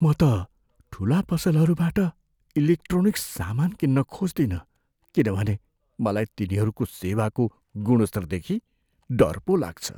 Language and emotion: Nepali, fearful